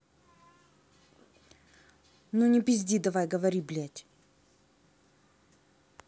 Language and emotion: Russian, angry